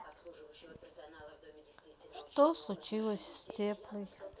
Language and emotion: Russian, sad